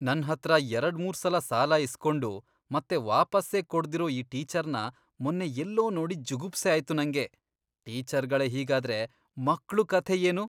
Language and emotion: Kannada, disgusted